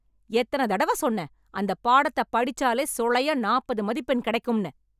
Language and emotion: Tamil, angry